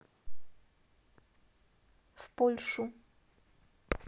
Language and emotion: Russian, neutral